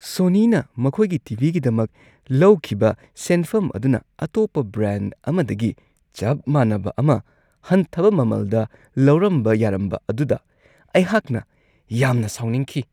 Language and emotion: Manipuri, disgusted